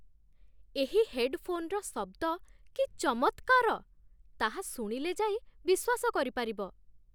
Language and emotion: Odia, surprised